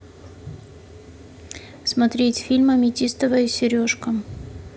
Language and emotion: Russian, neutral